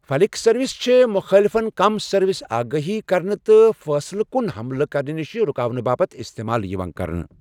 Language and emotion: Kashmiri, neutral